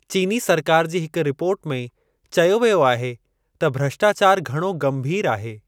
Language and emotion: Sindhi, neutral